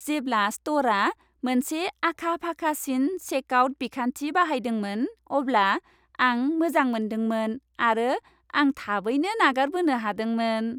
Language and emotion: Bodo, happy